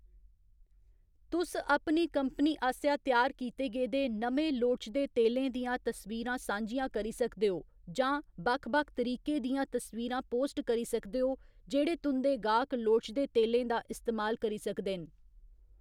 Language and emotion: Dogri, neutral